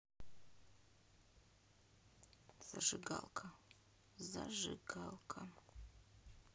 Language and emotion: Russian, sad